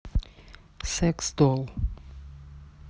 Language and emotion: Russian, neutral